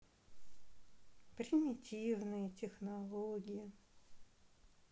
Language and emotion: Russian, sad